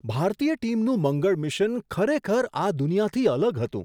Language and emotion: Gujarati, surprised